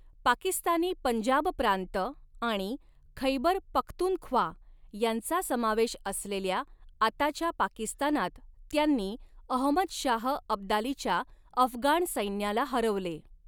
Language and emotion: Marathi, neutral